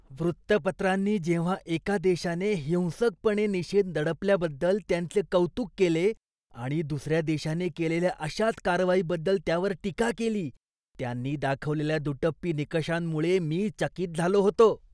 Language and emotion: Marathi, disgusted